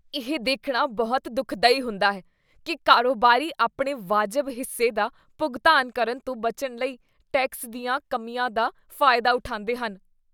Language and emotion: Punjabi, disgusted